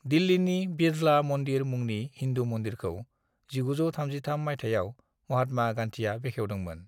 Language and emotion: Bodo, neutral